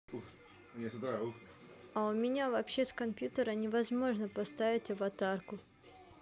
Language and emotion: Russian, sad